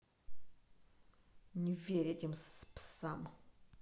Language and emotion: Russian, angry